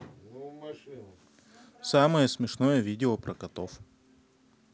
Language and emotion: Russian, neutral